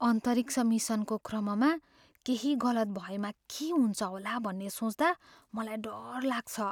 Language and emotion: Nepali, fearful